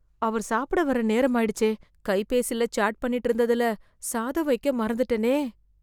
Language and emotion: Tamil, fearful